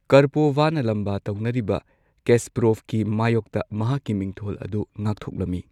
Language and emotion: Manipuri, neutral